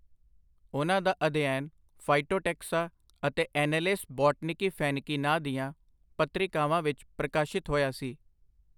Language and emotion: Punjabi, neutral